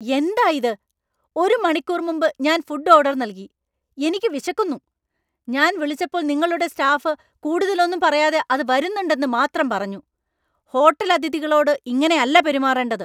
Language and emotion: Malayalam, angry